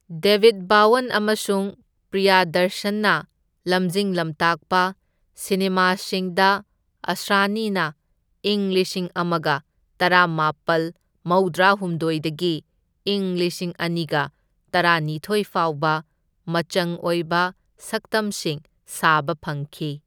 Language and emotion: Manipuri, neutral